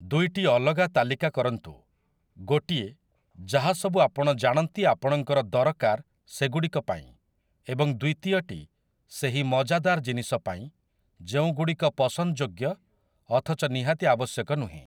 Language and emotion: Odia, neutral